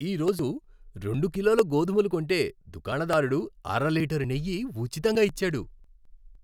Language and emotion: Telugu, happy